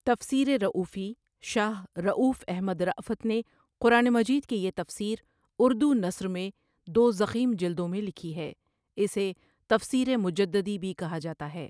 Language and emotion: Urdu, neutral